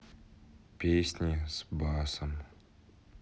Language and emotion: Russian, neutral